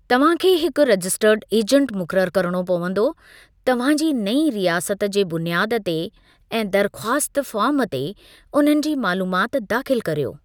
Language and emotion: Sindhi, neutral